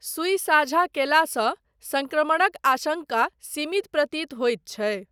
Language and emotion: Maithili, neutral